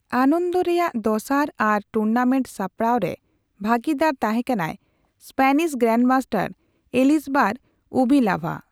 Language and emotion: Santali, neutral